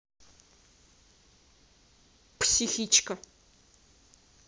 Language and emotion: Russian, angry